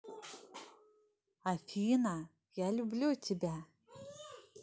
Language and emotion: Russian, positive